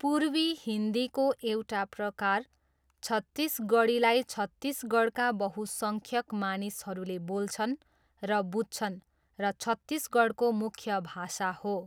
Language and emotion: Nepali, neutral